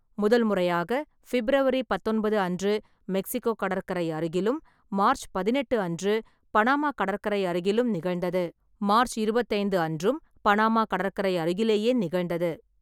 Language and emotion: Tamil, neutral